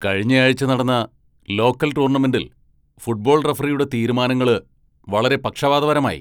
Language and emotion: Malayalam, angry